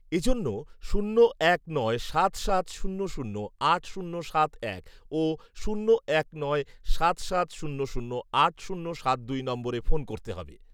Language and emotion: Bengali, neutral